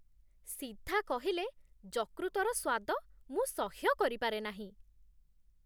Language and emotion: Odia, disgusted